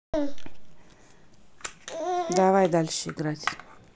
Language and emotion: Russian, neutral